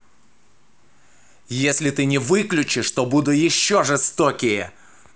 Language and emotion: Russian, angry